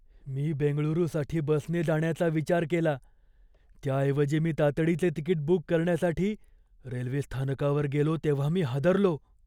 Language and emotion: Marathi, fearful